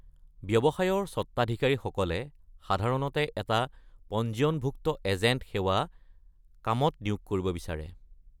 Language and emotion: Assamese, neutral